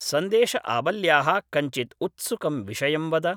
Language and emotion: Sanskrit, neutral